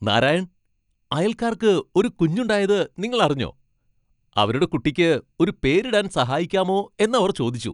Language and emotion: Malayalam, happy